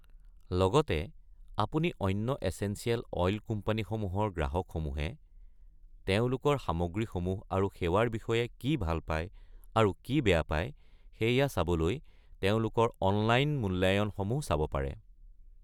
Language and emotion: Assamese, neutral